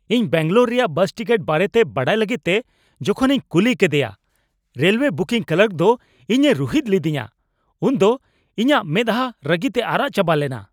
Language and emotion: Santali, angry